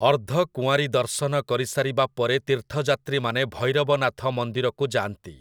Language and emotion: Odia, neutral